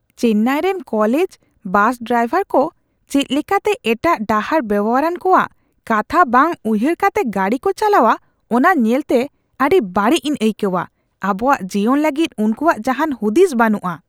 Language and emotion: Santali, disgusted